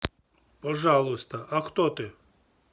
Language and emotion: Russian, neutral